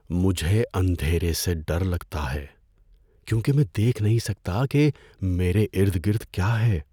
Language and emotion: Urdu, fearful